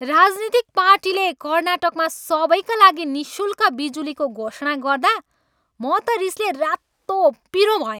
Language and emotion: Nepali, angry